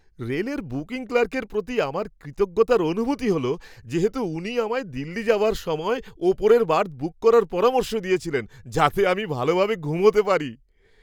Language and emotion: Bengali, happy